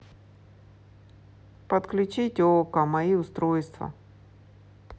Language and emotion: Russian, neutral